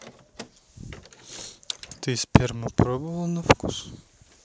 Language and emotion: Russian, neutral